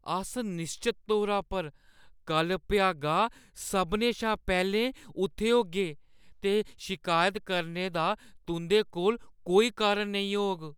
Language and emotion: Dogri, fearful